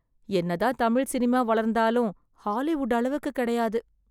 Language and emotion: Tamil, sad